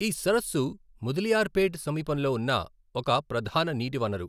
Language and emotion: Telugu, neutral